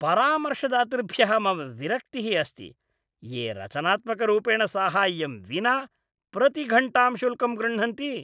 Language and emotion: Sanskrit, disgusted